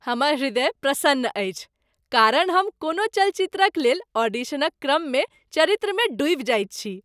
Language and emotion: Maithili, happy